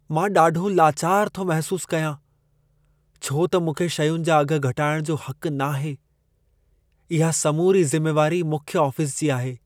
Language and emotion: Sindhi, sad